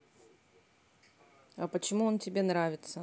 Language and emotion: Russian, neutral